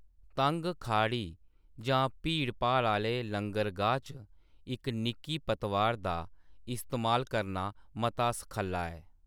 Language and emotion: Dogri, neutral